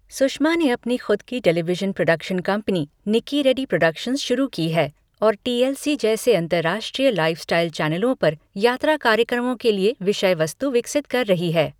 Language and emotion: Hindi, neutral